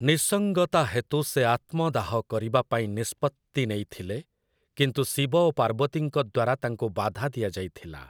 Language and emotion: Odia, neutral